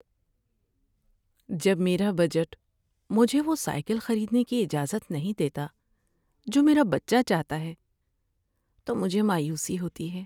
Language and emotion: Urdu, sad